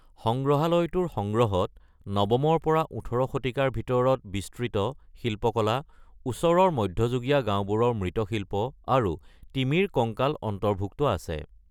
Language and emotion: Assamese, neutral